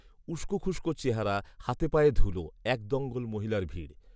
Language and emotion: Bengali, neutral